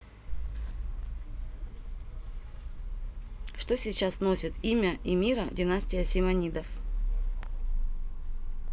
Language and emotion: Russian, neutral